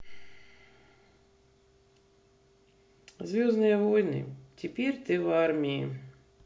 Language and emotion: Russian, neutral